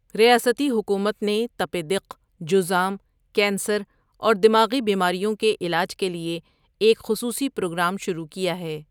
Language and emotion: Urdu, neutral